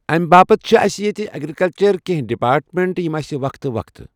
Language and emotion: Kashmiri, neutral